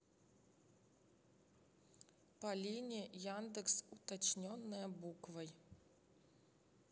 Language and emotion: Russian, neutral